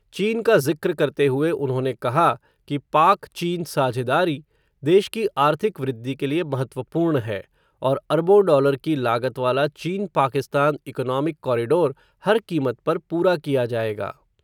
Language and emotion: Hindi, neutral